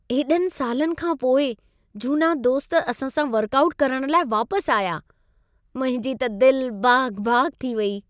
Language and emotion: Sindhi, happy